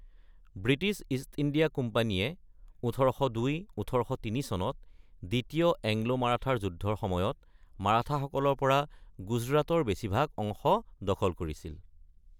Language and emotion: Assamese, neutral